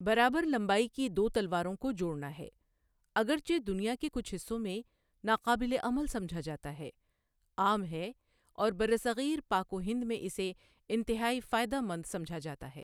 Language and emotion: Urdu, neutral